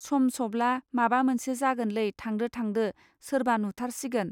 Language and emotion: Bodo, neutral